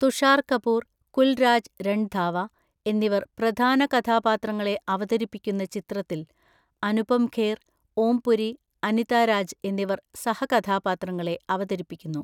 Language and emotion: Malayalam, neutral